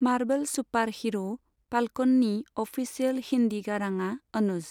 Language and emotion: Bodo, neutral